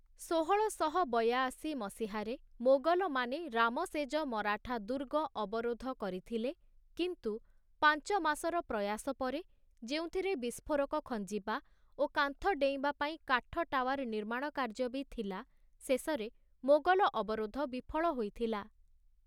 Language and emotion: Odia, neutral